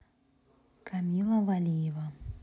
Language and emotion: Russian, neutral